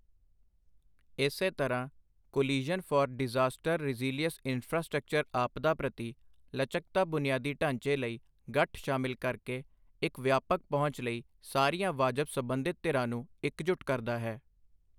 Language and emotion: Punjabi, neutral